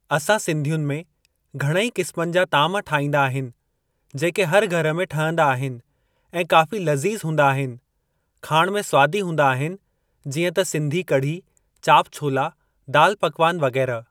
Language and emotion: Sindhi, neutral